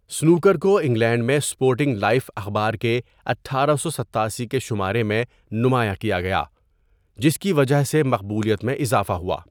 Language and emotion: Urdu, neutral